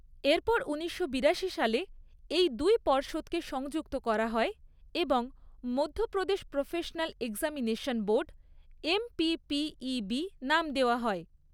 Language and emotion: Bengali, neutral